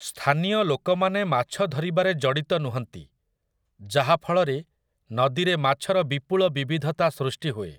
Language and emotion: Odia, neutral